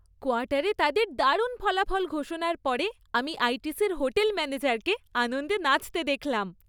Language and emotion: Bengali, happy